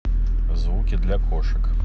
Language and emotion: Russian, neutral